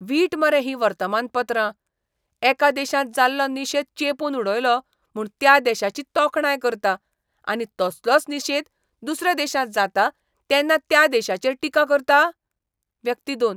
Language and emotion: Goan Konkani, disgusted